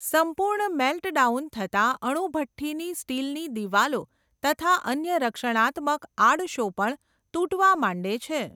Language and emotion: Gujarati, neutral